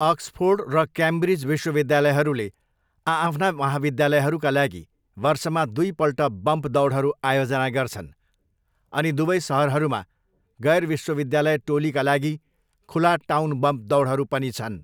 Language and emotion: Nepali, neutral